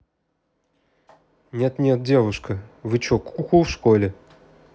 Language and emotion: Russian, neutral